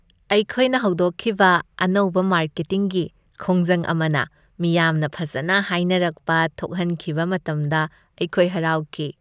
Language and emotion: Manipuri, happy